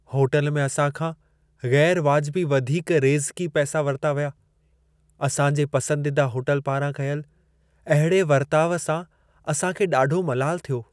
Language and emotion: Sindhi, sad